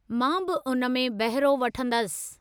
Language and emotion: Sindhi, neutral